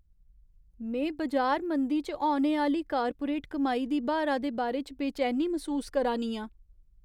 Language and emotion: Dogri, fearful